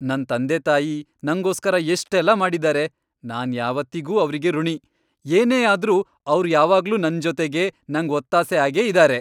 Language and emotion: Kannada, happy